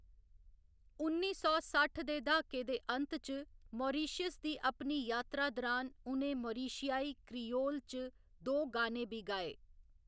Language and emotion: Dogri, neutral